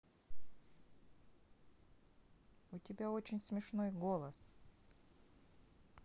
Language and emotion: Russian, neutral